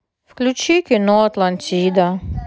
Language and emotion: Russian, sad